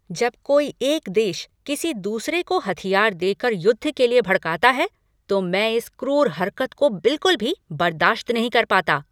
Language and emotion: Hindi, angry